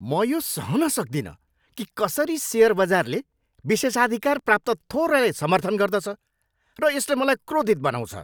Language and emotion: Nepali, angry